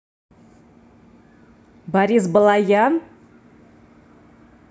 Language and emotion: Russian, neutral